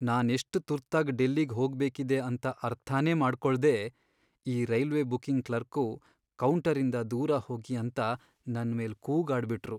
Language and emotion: Kannada, sad